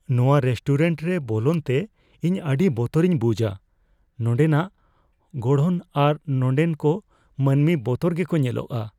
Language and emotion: Santali, fearful